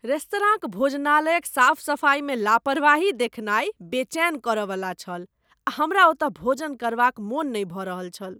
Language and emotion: Maithili, disgusted